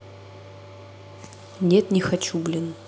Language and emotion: Russian, neutral